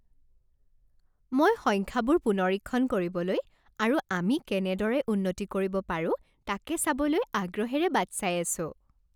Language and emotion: Assamese, happy